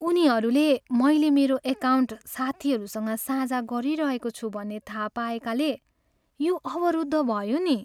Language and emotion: Nepali, sad